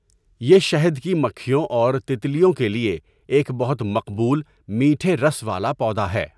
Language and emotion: Urdu, neutral